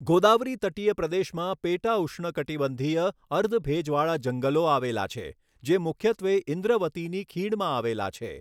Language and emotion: Gujarati, neutral